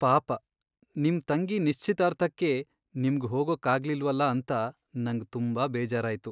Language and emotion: Kannada, sad